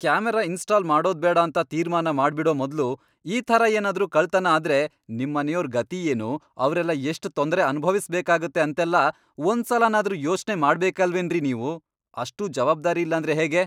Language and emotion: Kannada, angry